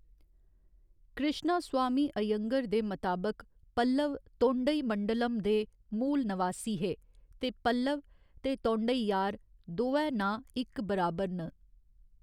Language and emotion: Dogri, neutral